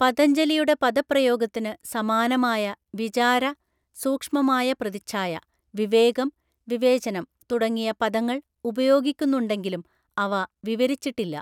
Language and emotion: Malayalam, neutral